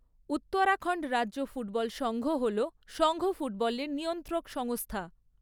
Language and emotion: Bengali, neutral